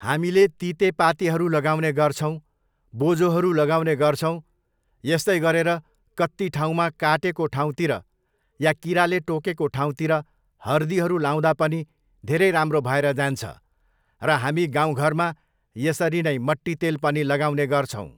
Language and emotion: Nepali, neutral